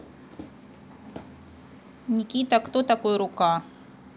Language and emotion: Russian, neutral